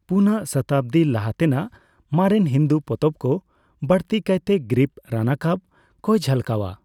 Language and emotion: Santali, neutral